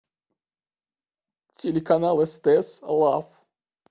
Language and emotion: Russian, sad